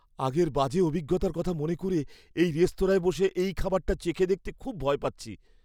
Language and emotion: Bengali, fearful